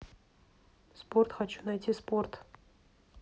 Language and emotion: Russian, neutral